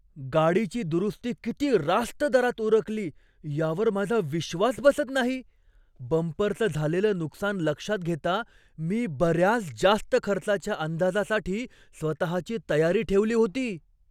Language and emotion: Marathi, surprised